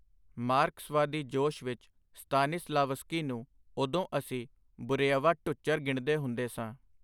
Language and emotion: Punjabi, neutral